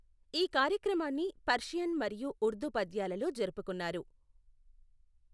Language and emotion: Telugu, neutral